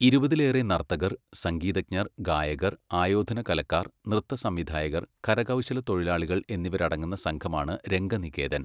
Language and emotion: Malayalam, neutral